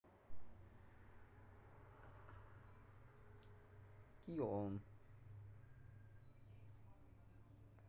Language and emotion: Russian, neutral